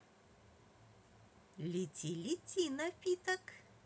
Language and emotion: Russian, positive